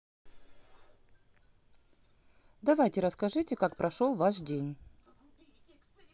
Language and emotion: Russian, neutral